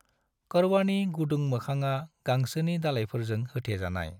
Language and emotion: Bodo, neutral